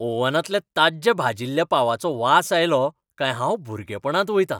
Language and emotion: Goan Konkani, happy